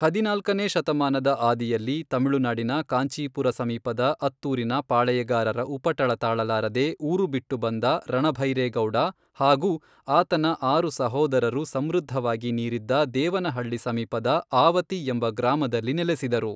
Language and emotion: Kannada, neutral